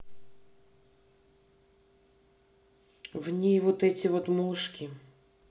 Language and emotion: Russian, neutral